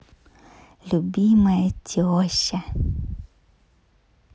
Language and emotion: Russian, positive